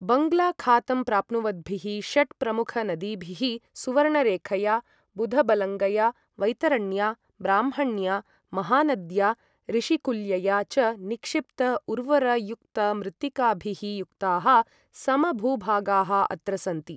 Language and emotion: Sanskrit, neutral